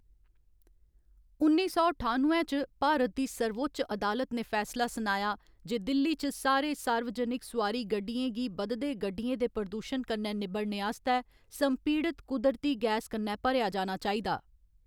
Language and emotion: Dogri, neutral